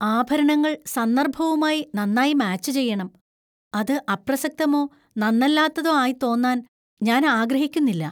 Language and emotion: Malayalam, fearful